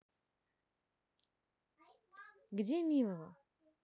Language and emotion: Russian, neutral